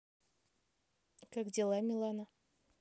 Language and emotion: Russian, neutral